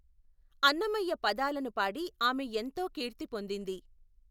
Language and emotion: Telugu, neutral